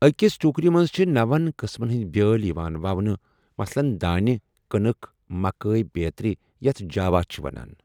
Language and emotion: Kashmiri, neutral